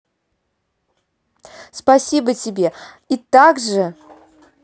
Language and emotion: Russian, positive